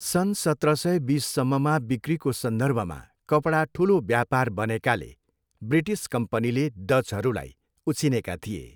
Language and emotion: Nepali, neutral